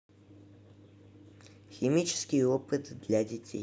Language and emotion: Russian, neutral